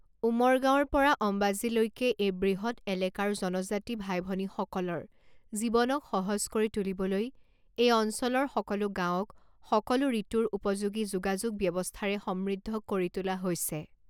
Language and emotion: Assamese, neutral